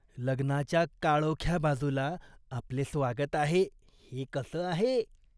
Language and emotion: Marathi, disgusted